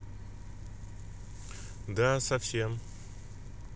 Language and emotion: Russian, neutral